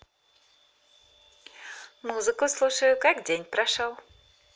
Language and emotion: Russian, positive